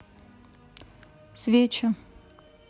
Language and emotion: Russian, neutral